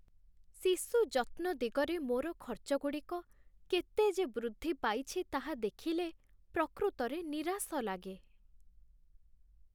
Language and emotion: Odia, sad